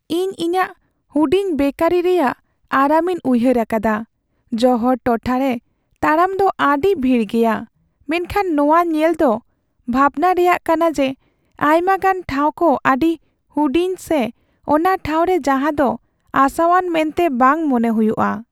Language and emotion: Santali, sad